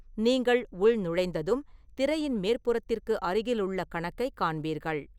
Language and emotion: Tamil, neutral